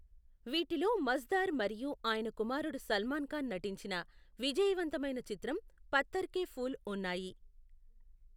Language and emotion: Telugu, neutral